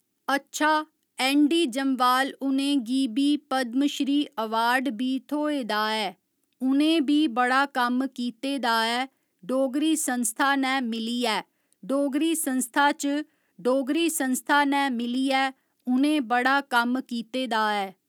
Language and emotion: Dogri, neutral